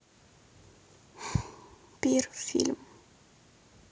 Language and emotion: Russian, sad